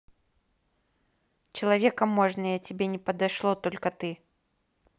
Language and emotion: Russian, angry